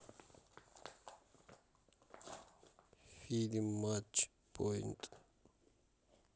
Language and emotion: Russian, neutral